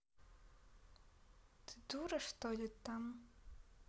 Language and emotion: Russian, neutral